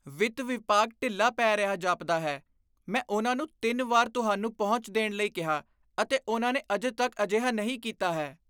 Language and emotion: Punjabi, disgusted